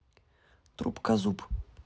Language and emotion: Russian, neutral